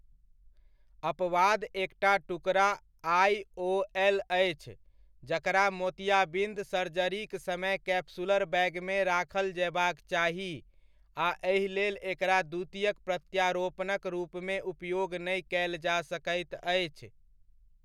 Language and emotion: Maithili, neutral